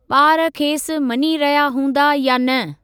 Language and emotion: Sindhi, neutral